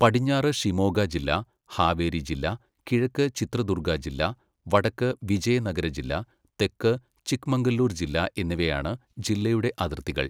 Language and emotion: Malayalam, neutral